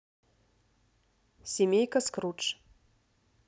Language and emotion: Russian, neutral